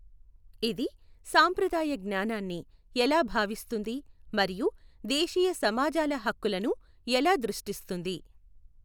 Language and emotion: Telugu, neutral